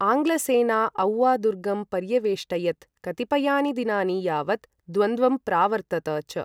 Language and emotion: Sanskrit, neutral